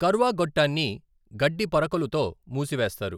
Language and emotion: Telugu, neutral